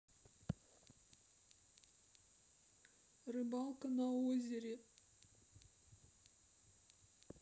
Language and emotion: Russian, sad